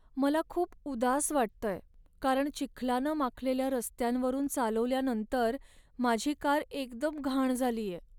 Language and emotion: Marathi, sad